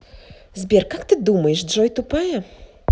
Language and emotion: Russian, angry